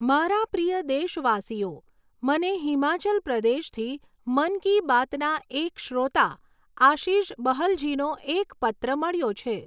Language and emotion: Gujarati, neutral